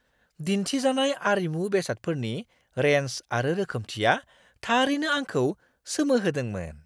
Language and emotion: Bodo, surprised